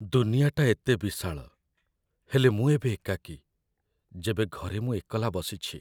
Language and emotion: Odia, sad